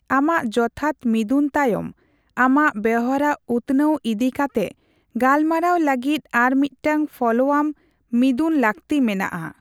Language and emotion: Santali, neutral